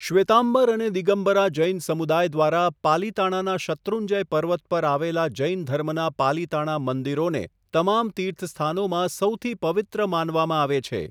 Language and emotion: Gujarati, neutral